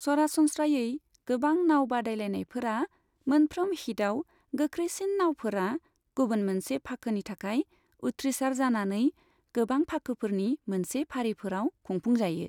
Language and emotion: Bodo, neutral